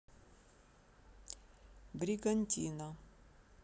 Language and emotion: Russian, neutral